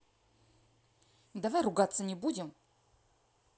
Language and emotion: Russian, angry